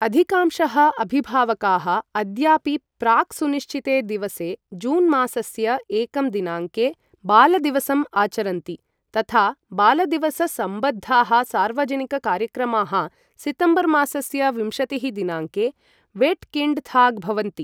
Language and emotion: Sanskrit, neutral